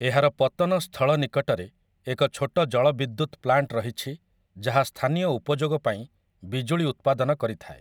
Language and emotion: Odia, neutral